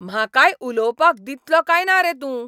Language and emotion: Goan Konkani, angry